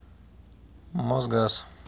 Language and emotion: Russian, neutral